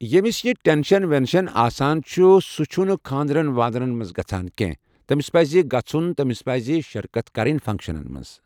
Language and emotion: Kashmiri, neutral